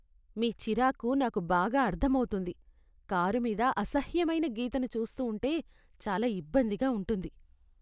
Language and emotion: Telugu, disgusted